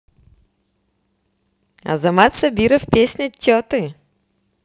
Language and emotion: Russian, positive